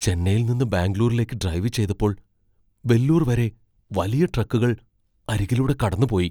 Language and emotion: Malayalam, fearful